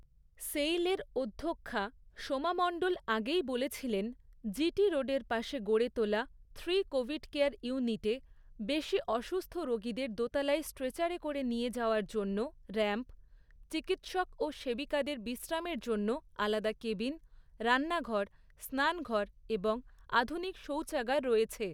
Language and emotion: Bengali, neutral